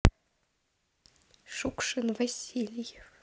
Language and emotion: Russian, neutral